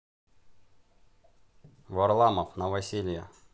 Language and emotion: Russian, neutral